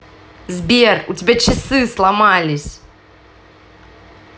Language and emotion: Russian, angry